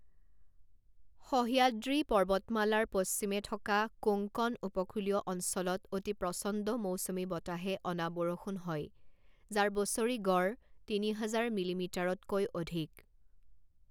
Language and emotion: Assamese, neutral